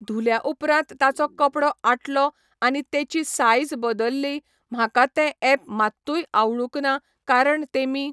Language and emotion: Goan Konkani, neutral